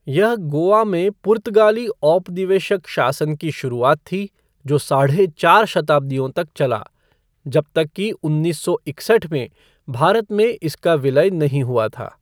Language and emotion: Hindi, neutral